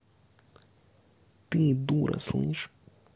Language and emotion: Russian, angry